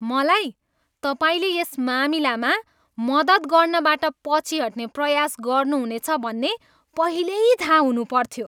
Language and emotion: Nepali, disgusted